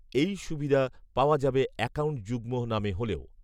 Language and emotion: Bengali, neutral